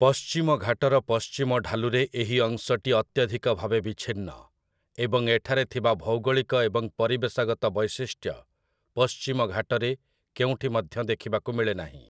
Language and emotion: Odia, neutral